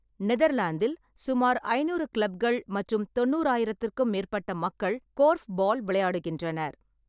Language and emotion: Tamil, neutral